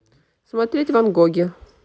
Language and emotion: Russian, neutral